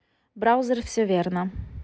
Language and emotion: Russian, neutral